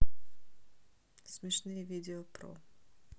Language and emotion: Russian, neutral